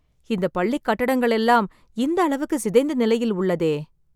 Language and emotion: Tamil, sad